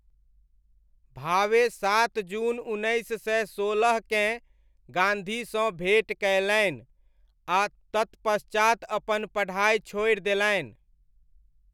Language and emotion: Maithili, neutral